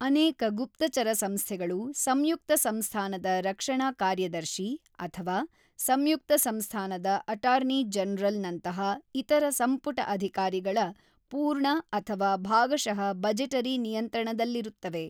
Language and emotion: Kannada, neutral